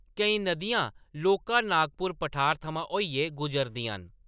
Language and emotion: Dogri, neutral